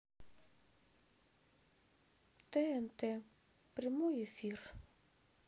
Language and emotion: Russian, sad